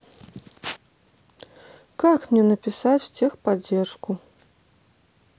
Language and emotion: Russian, positive